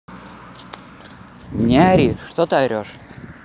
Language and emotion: Russian, neutral